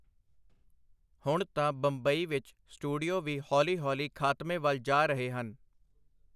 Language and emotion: Punjabi, neutral